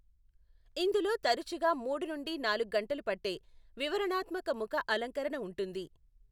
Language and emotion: Telugu, neutral